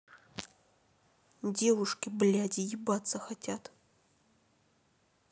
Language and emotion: Russian, angry